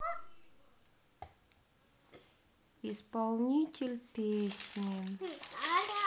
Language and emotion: Russian, sad